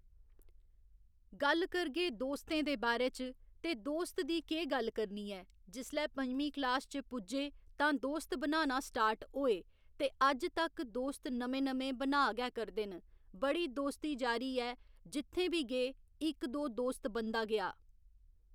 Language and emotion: Dogri, neutral